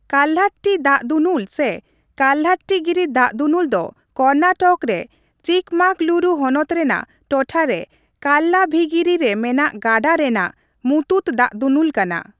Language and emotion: Santali, neutral